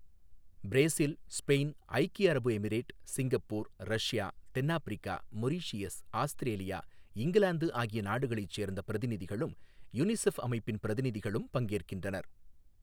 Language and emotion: Tamil, neutral